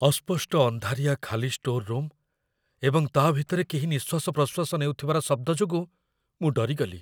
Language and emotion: Odia, fearful